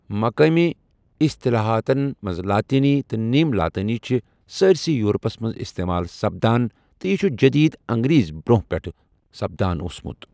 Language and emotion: Kashmiri, neutral